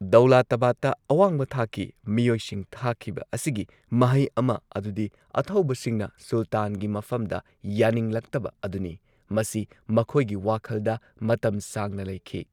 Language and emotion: Manipuri, neutral